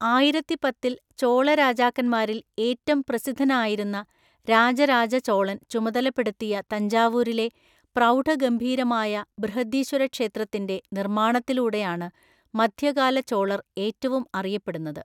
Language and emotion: Malayalam, neutral